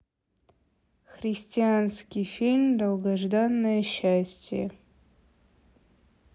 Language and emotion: Russian, neutral